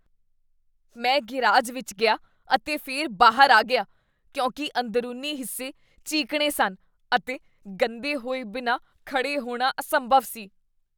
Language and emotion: Punjabi, disgusted